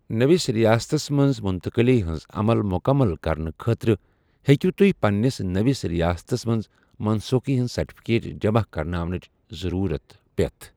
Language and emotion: Kashmiri, neutral